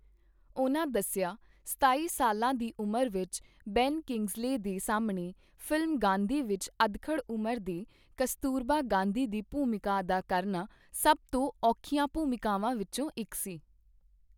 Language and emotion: Punjabi, neutral